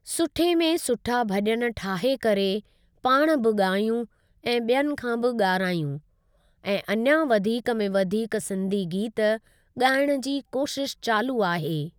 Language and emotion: Sindhi, neutral